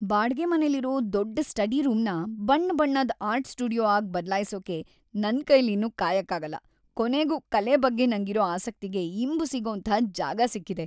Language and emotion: Kannada, happy